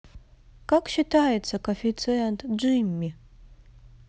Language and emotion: Russian, neutral